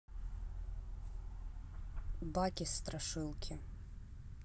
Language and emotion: Russian, neutral